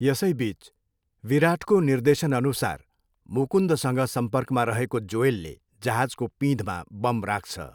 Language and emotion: Nepali, neutral